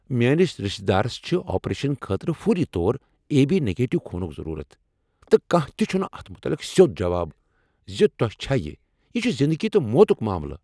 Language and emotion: Kashmiri, angry